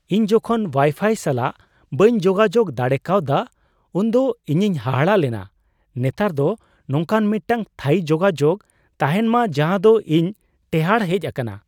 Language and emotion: Santali, surprised